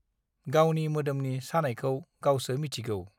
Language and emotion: Bodo, neutral